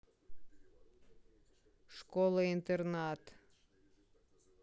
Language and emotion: Russian, angry